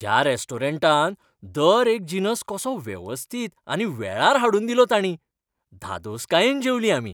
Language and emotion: Goan Konkani, happy